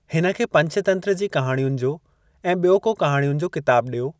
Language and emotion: Sindhi, neutral